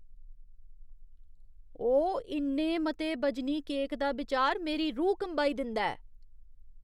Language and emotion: Dogri, disgusted